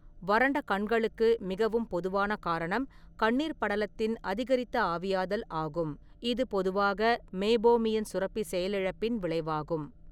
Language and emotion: Tamil, neutral